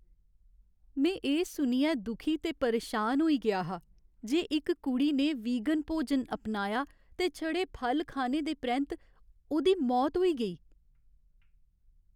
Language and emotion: Dogri, sad